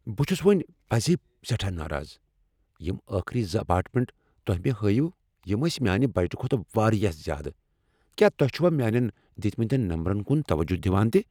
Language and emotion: Kashmiri, angry